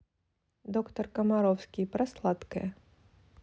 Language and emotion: Russian, neutral